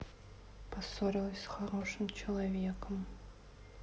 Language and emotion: Russian, sad